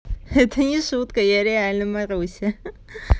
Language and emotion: Russian, positive